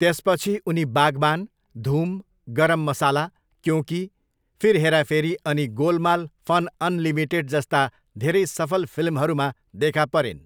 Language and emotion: Nepali, neutral